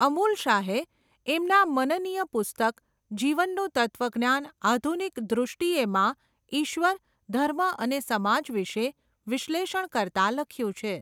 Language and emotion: Gujarati, neutral